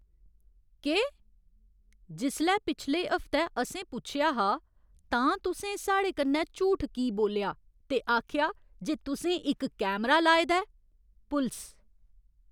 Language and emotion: Dogri, angry